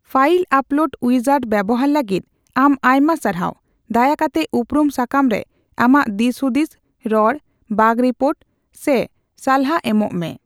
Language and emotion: Santali, neutral